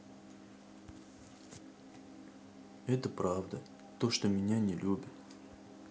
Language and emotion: Russian, sad